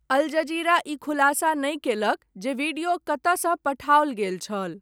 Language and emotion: Maithili, neutral